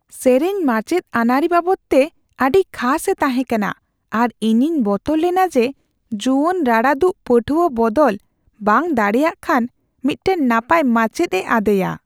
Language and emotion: Santali, fearful